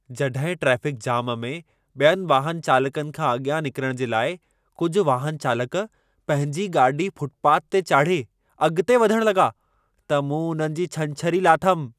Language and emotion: Sindhi, angry